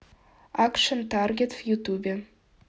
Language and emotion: Russian, neutral